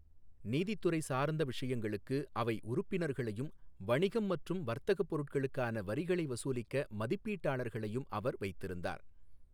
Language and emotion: Tamil, neutral